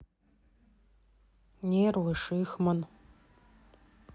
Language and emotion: Russian, neutral